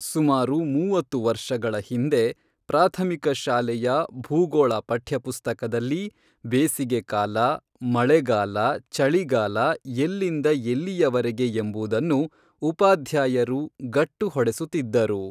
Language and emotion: Kannada, neutral